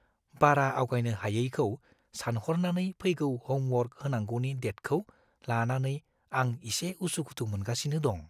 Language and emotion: Bodo, fearful